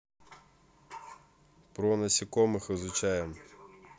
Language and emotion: Russian, neutral